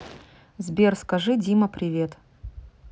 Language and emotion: Russian, neutral